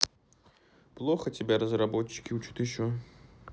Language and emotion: Russian, sad